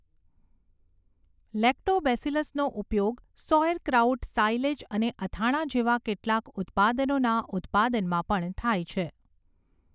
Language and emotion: Gujarati, neutral